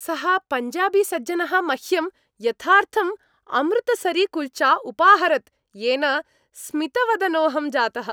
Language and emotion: Sanskrit, happy